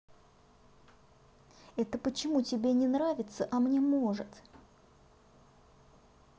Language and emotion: Russian, neutral